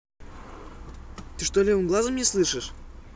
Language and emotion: Russian, neutral